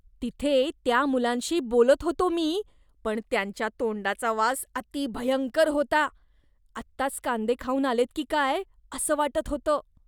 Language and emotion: Marathi, disgusted